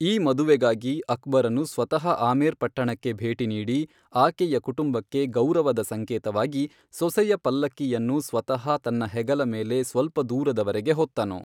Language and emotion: Kannada, neutral